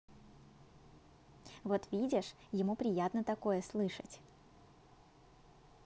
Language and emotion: Russian, positive